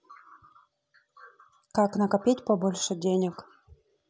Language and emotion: Russian, neutral